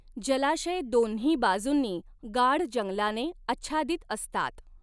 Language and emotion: Marathi, neutral